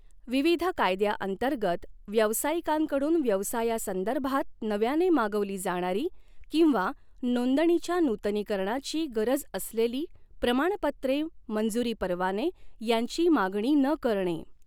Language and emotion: Marathi, neutral